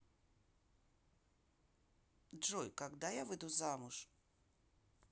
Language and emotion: Russian, neutral